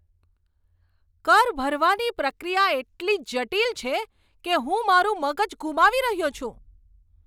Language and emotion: Gujarati, angry